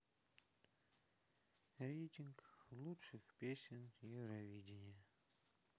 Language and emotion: Russian, sad